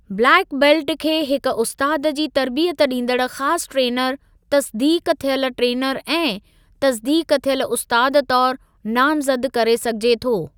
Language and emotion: Sindhi, neutral